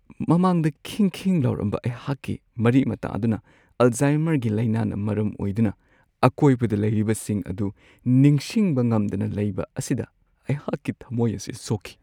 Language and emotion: Manipuri, sad